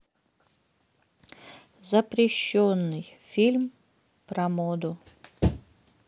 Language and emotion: Russian, sad